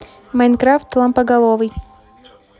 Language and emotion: Russian, neutral